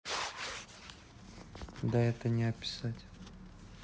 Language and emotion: Russian, neutral